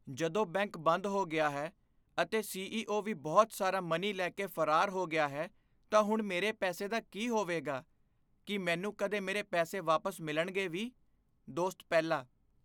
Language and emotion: Punjabi, fearful